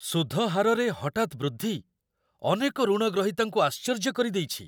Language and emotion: Odia, surprised